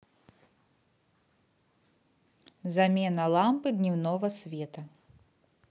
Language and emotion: Russian, neutral